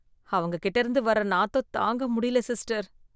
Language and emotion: Tamil, disgusted